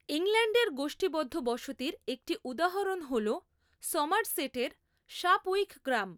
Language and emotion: Bengali, neutral